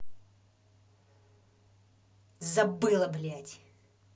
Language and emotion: Russian, angry